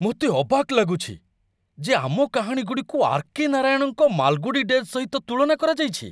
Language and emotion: Odia, surprised